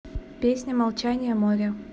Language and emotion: Russian, neutral